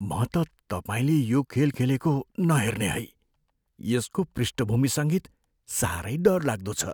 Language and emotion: Nepali, fearful